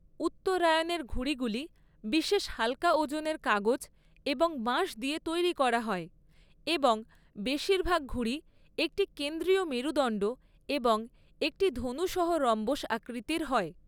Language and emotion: Bengali, neutral